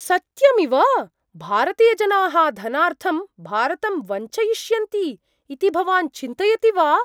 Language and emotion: Sanskrit, surprised